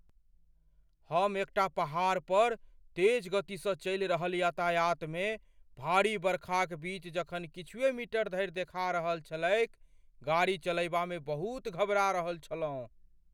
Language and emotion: Maithili, fearful